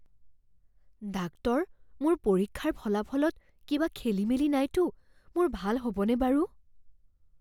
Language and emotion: Assamese, fearful